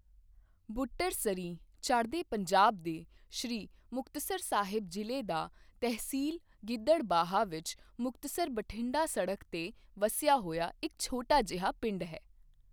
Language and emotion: Punjabi, neutral